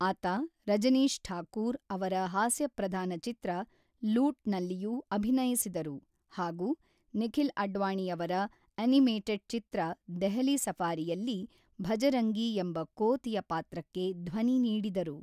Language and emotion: Kannada, neutral